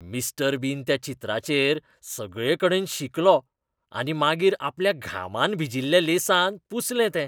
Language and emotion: Goan Konkani, disgusted